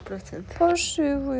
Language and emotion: Russian, sad